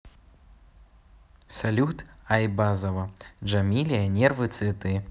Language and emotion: Russian, neutral